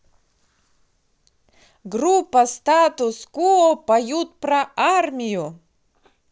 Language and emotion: Russian, positive